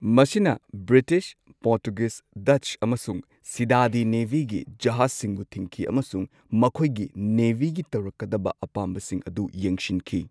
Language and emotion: Manipuri, neutral